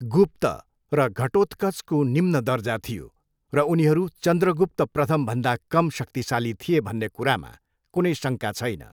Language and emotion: Nepali, neutral